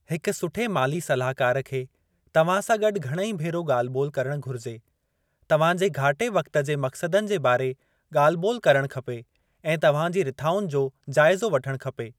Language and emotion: Sindhi, neutral